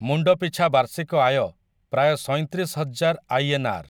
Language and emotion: Odia, neutral